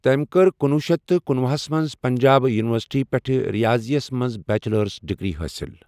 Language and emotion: Kashmiri, neutral